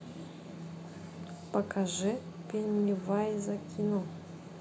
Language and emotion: Russian, neutral